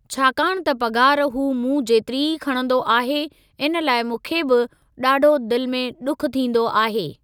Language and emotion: Sindhi, neutral